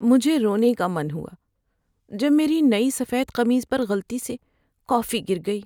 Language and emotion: Urdu, sad